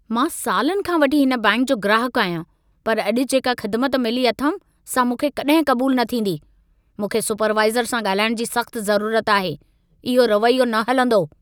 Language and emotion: Sindhi, angry